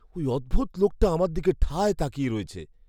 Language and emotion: Bengali, fearful